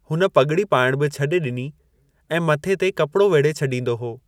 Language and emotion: Sindhi, neutral